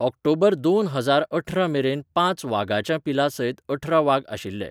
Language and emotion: Goan Konkani, neutral